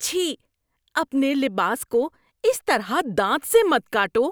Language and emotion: Urdu, disgusted